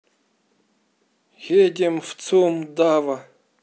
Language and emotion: Russian, neutral